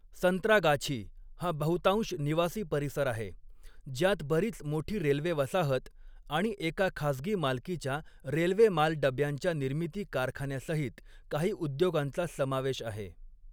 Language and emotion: Marathi, neutral